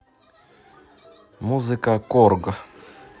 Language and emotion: Russian, neutral